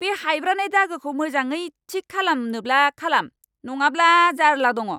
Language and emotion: Bodo, angry